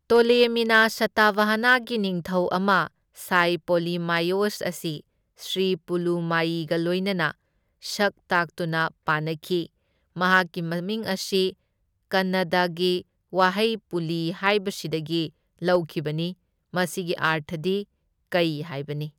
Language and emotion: Manipuri, neutral